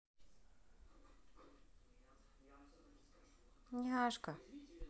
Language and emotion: Russian, positive